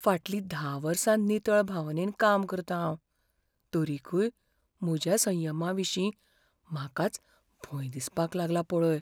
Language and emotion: Goan Konkani, fearful